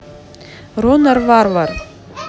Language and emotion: Russian, neutral